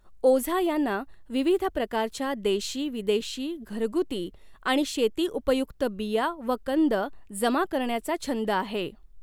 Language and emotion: Marathi, neutral